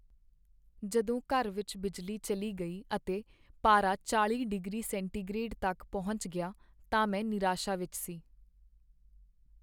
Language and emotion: Punjabi, sad